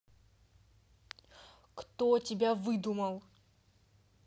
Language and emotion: Russian, angry